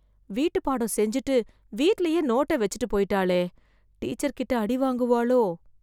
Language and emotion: Tamil, fearful